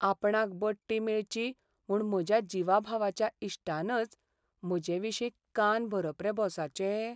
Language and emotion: Goan Konkani, sad